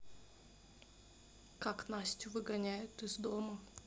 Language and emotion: Russian, neutral